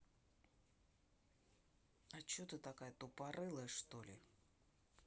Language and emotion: Russian, angry